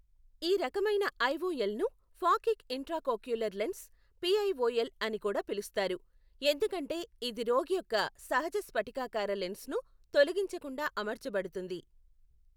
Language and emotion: Telugu, neutral